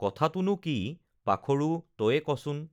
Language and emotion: Assamese, neutral